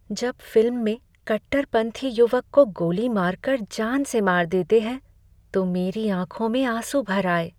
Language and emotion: Hindi, sad